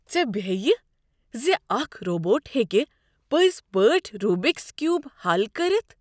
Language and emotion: Kashmiri, surprised